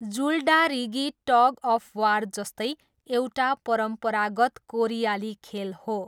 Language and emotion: Nepali, neutral